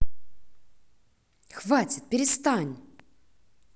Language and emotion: Russian, angry